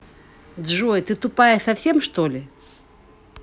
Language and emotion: Russian, angry